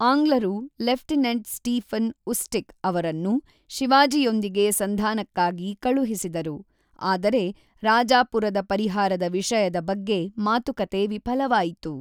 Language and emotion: Kannada, neutral